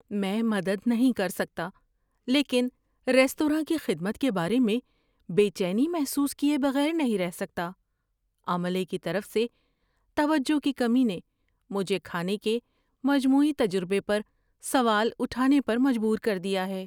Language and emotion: Urdu, fearful